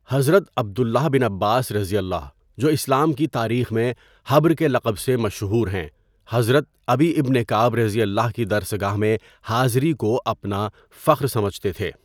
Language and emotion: Urdu, neutral